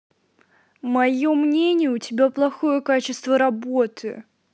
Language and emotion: Russian, angry